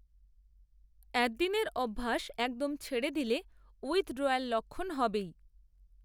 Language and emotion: Bengali, neutral